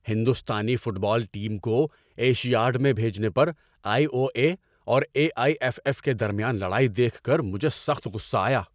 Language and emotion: Urdu, angry